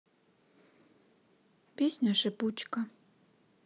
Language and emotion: Russian, sad